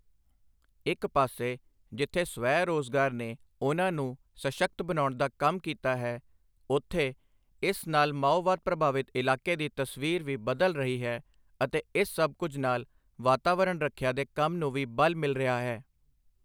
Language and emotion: Punjabi, neutral